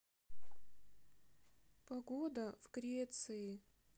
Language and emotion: Russian, sad